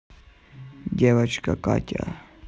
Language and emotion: Russian, neutral